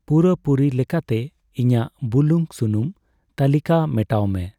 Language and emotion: Santali, neutral